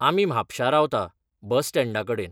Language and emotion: Goan Konkani, neutral